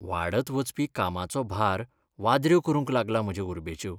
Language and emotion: Goan Konkani, sad